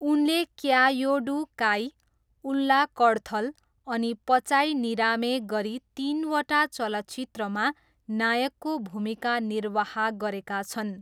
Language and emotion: Nepali, neutral